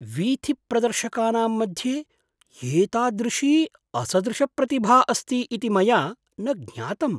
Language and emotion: Sanskrit, surprised